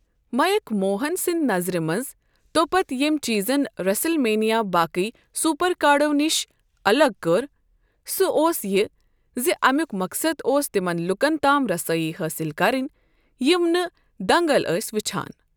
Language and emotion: Kashmiri, neutral